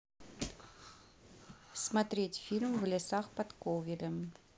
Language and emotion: Russian, neutral